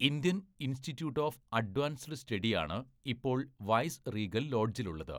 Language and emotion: Malayalam, neutral